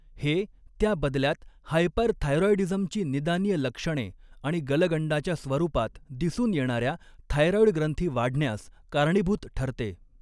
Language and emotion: Marathi, neutral